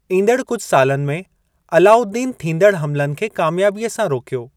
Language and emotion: Sindhi, neutral